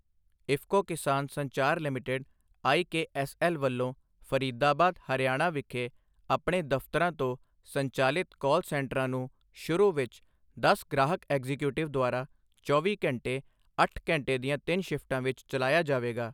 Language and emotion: Punjabi, neutral